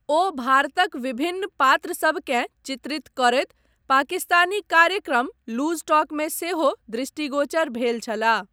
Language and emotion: Maithili, neutral